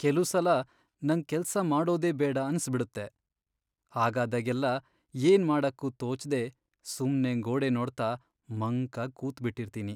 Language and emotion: Kannada, sad